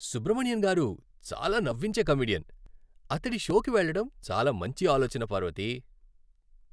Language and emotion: Telugu, happy